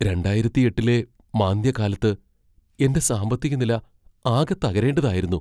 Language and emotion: Malayalam, fearful